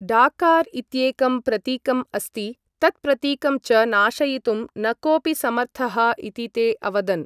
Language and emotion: Sanskrit, neutral